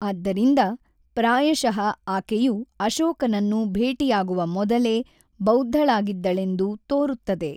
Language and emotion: Kannada, neutral